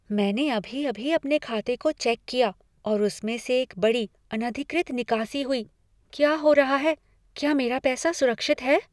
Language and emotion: Hindi, fearful